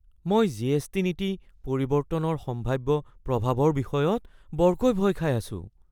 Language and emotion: Assamese, fearful